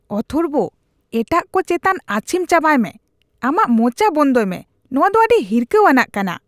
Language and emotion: Santali, disgusted